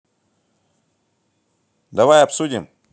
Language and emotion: Russian, angry